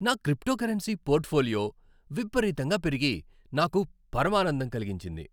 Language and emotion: Telugu, happy